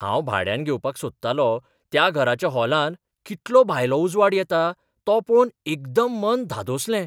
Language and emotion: Goan Konkani, surprised